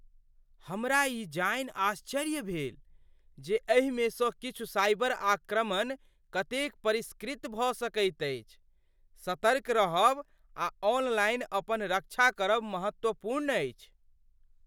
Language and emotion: Maithili, surprised